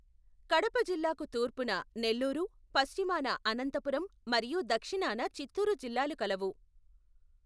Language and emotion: Telugu, neutral